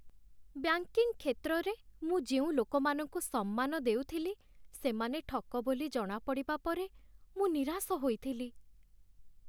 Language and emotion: Odia, sad